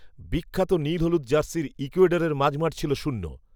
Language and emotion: Bengali, neutral